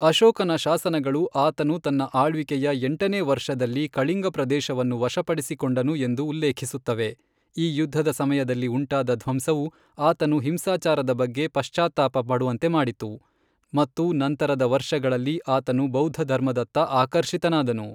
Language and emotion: Kannada, neutral